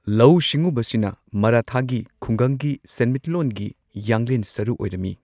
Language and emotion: Manipuri, neutral